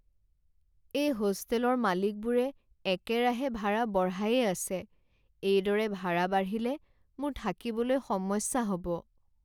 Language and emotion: Assamese, sad